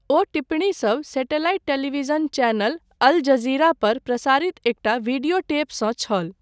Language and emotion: Maithili, neutral